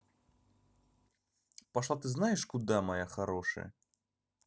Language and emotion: Russian, angry